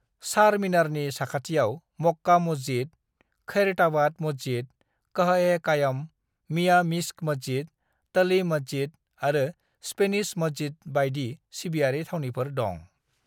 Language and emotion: Bodo, neutral